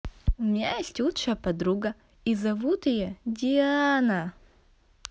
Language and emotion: Russian, positive